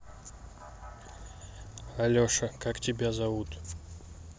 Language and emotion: Russian, neutral